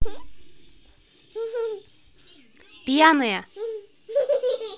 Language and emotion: Russian, neutral